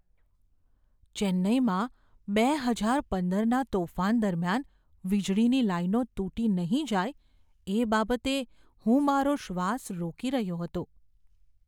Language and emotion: Gujarati, fearful